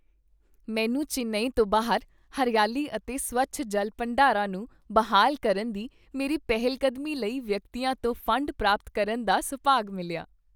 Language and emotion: Punjabi, happy